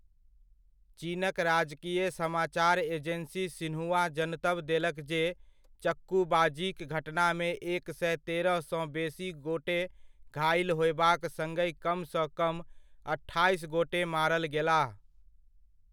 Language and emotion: Maithili, neutral